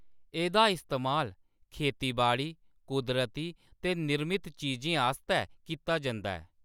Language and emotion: Dogri, neutral